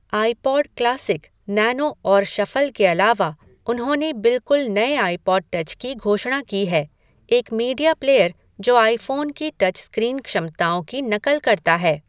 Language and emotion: Hindi, neutral